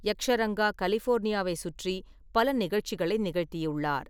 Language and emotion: Tamil, neutral